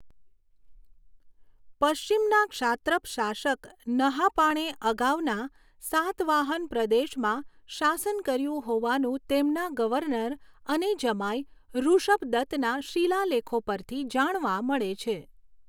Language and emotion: Gujarati, neutral